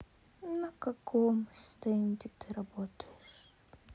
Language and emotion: Russian, sad